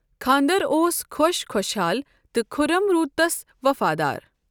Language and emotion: Kashmiri, neutral